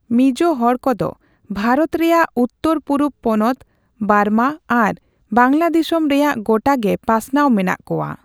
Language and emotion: Santali, neutral